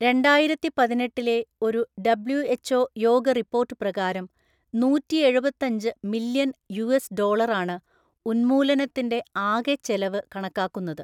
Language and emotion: Malayalam, neutral